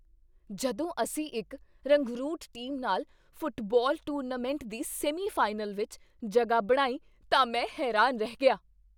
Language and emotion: Punjabi, surprised